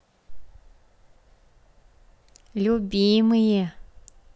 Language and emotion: Russian, positive